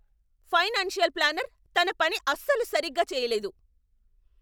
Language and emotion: Telugu, angry